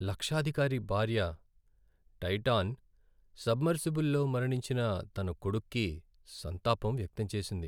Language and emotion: Telugu, sad